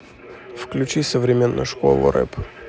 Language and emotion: Russian, neutral